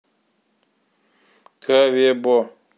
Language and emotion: Russian, neutral